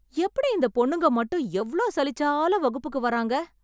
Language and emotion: Tamil, surprised